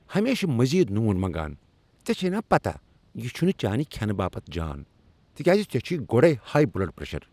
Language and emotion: Kashmiri, angry